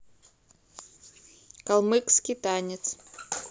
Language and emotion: Russian, neutral